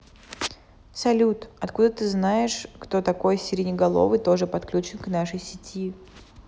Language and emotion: Russian, neutral